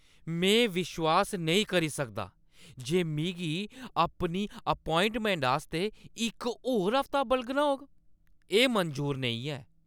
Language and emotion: Dogri, angry